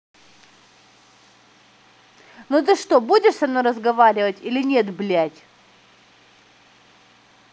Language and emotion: Russian, angry